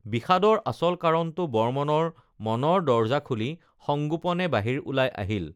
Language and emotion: Assamese, neutral